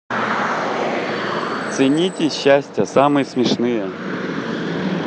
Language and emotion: Russian, positive